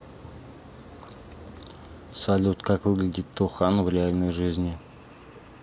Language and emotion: Russian, neutral